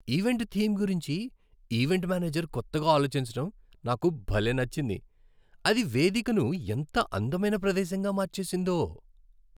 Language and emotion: Telugu, happy